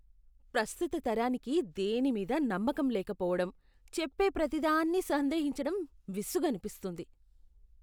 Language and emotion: Telugu, disgusted